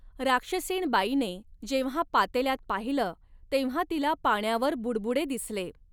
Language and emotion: Marathi, neutral